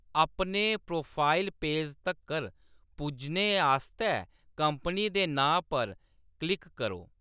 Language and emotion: Dogri, neutral